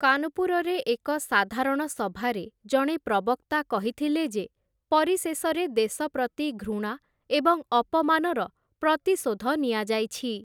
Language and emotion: Odia, neutral